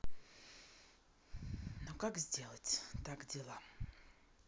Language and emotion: Russian, neutral